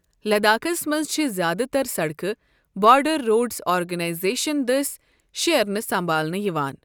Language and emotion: Kashmiri, neutral